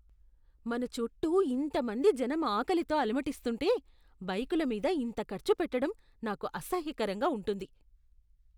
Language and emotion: Telugu, disgusted